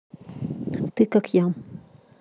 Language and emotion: Russian, neutral